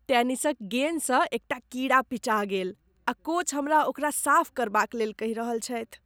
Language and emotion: Maithili, disgusted